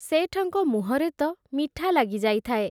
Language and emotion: Odia, neutral